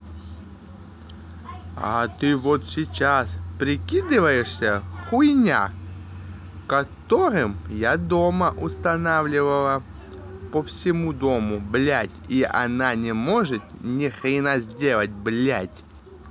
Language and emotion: Russian, angry